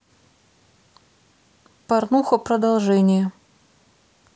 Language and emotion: Russian, neutral